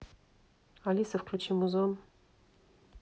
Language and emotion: Russian, neutral